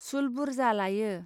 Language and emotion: Bodo, neutral